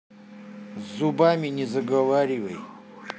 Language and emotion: Russian, neutral